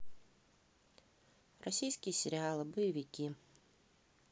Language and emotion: Russian, neutral